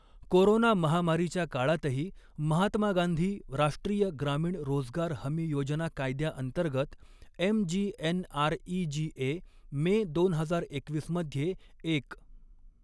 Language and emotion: Marathi, neutral